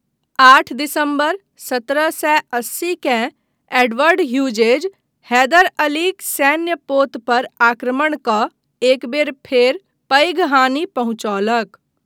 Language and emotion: Maithili, neutral